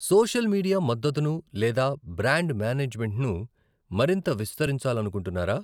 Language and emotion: Telugu, neutral